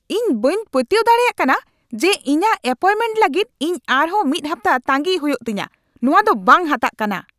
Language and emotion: Santali, angry